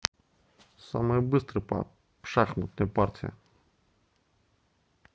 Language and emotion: Russian, neutral